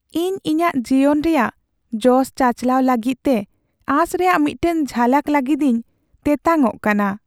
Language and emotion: Santali, sad